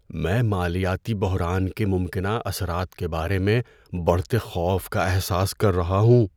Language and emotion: Urdu, fearful